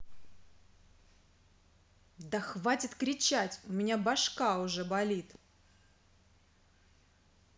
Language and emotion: Russian, angry